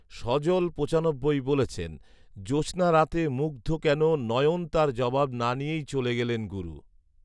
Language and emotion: Bengali, neutral